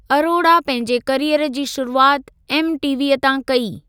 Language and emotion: Sindhi, neutral